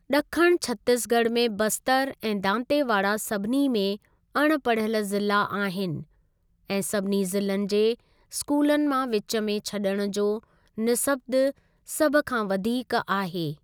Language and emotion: Sindhi, neutral